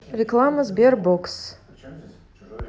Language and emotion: Russian, neutral